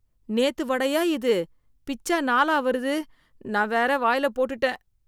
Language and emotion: Tamil, disgusted